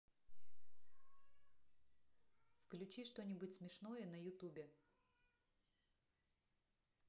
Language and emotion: Russian, neutral